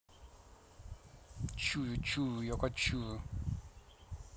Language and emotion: Russian, neutral